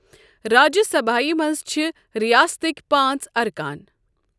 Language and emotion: Kashmiri, neutral